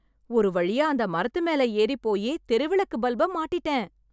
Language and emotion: Tamil, happy